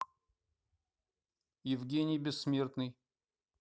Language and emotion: Russian, neutral